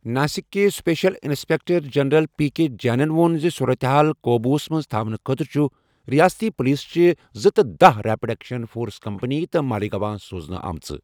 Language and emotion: Kashmiri, neutral